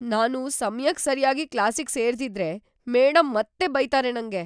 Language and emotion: Kannada, fearful